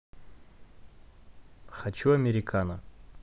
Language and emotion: Russian, neutral